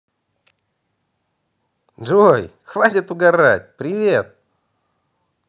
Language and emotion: Russian, positive